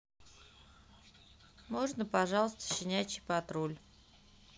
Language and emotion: Russian, neutral